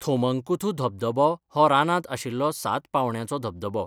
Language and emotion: Goan Konkani, neutral